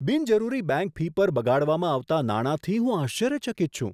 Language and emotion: Gujarati, surprised